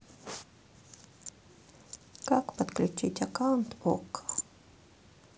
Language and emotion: Russian, sad